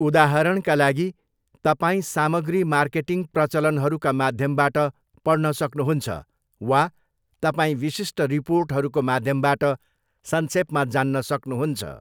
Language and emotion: Nepali, neutral